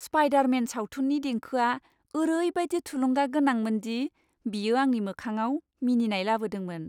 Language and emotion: Bodo, happy